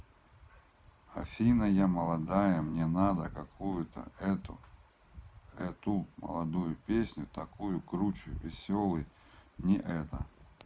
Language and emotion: Russian, neutral